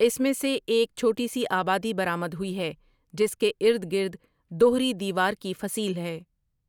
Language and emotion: Urdu, neutral